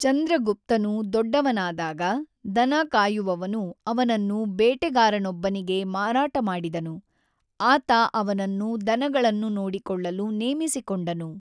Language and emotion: Kannada, neutral